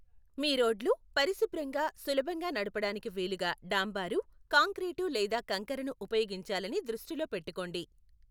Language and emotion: Telugu, neutral